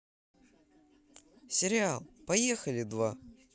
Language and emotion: Russian, positive